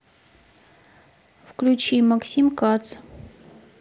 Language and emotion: Russian, neutral